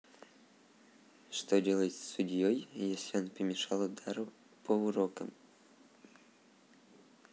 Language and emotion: Russian, neutral